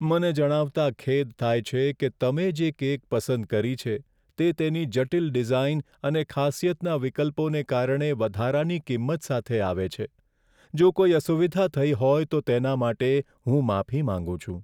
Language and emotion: Gujarati, sad